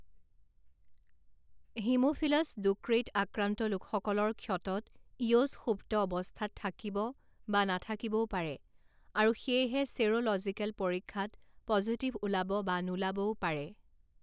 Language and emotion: Assamese, neutral